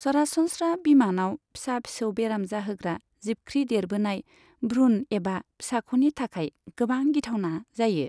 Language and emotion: Bodo, neutral